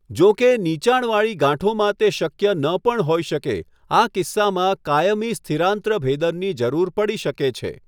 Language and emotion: Gujarati, neutral